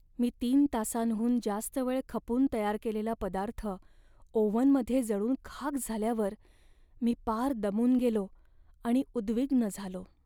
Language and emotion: Marathi, sad